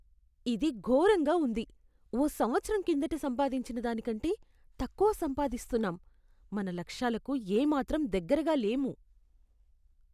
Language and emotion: Telugu, disgusted